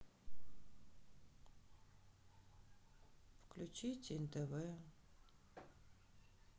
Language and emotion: Russian, sad